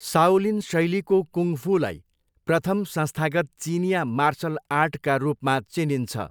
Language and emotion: Nepali, neutral